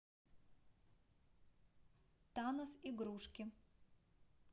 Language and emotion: Russian, neutral